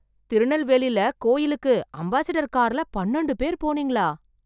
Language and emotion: Tamil, surprised